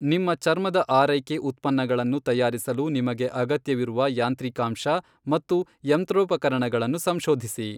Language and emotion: Kannada, neutral